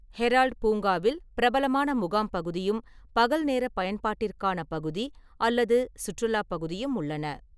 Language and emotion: Tamil, neutral